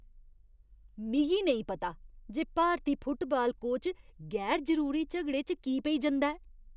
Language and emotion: Dogri, disgusted